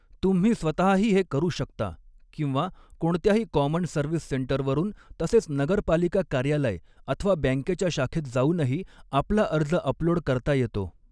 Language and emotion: Marathi, neutral